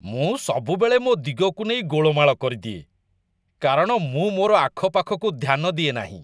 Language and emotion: Odia, disgusted